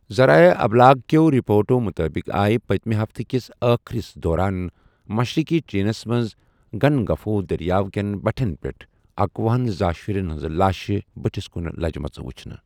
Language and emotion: Kashmiri, neutral